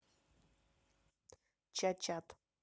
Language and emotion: Russian, neutral